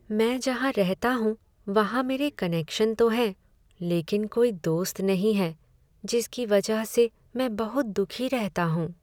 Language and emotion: Hindi, sad